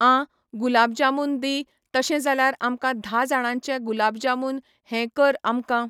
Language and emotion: Goan Konkani, neutral